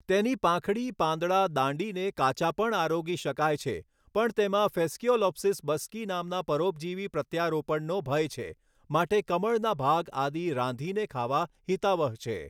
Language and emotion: Gujarati, neutral